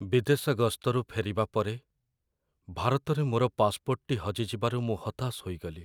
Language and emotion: Odia, sad